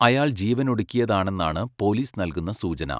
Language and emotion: Malayalam, neutral